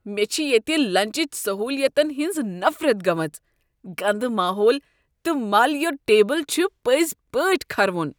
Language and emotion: Kashmiri, disgusted